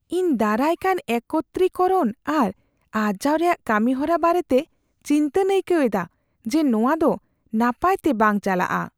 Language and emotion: Santali, fearful